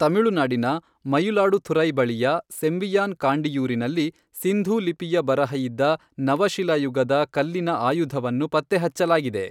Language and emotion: Kannada, neutral